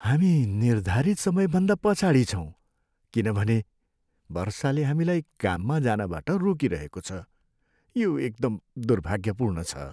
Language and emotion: Nepali, sad